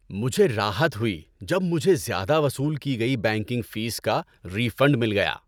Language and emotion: Urdu, happy